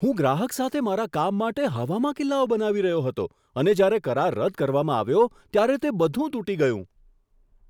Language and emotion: Gujarati, surprised